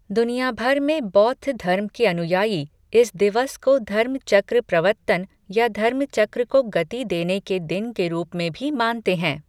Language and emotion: Hindi, neutral